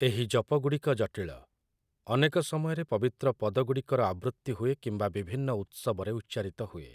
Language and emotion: Odia, neutral